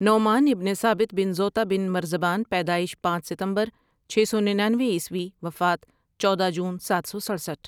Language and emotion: Urdu, neutral